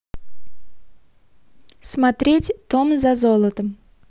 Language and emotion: Russian, neutral